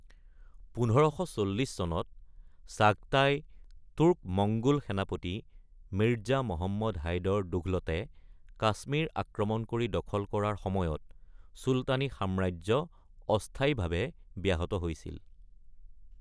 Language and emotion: Assamese, neutral